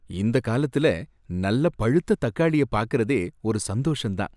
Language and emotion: Tamil, happy